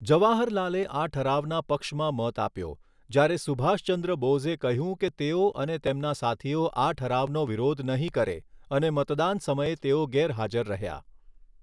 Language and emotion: Gujarati, neutral